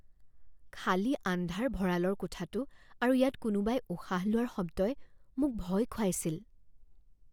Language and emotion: Assamese, fearful